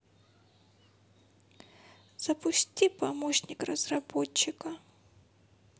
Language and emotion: Russian, sad